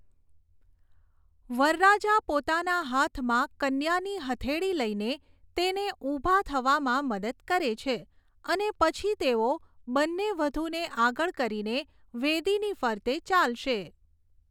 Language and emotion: Gujarati, neutral